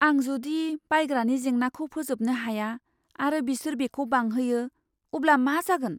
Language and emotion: Bodo, fearful